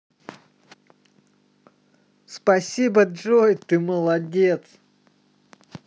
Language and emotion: Russian, positive